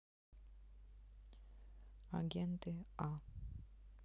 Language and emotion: Russian, neutral